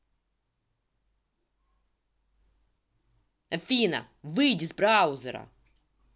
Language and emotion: Russian, angry